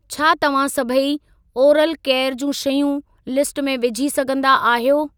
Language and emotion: Sindhi, neutral